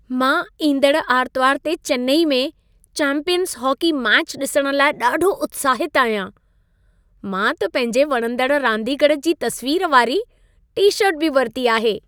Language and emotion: Sindhi, happy